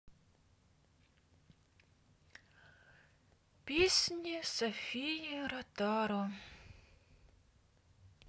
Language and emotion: Russian, sad